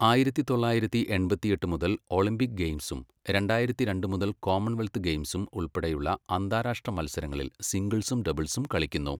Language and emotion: Malayalam, neutral